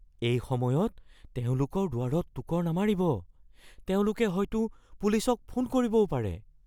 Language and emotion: Assamese, fearful